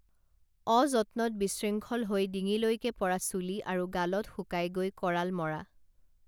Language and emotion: Assamese, neutral